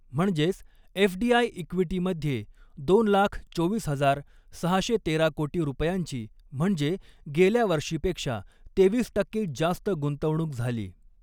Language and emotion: Marathi, neutral